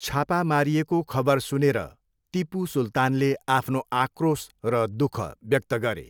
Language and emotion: Nepali, neutral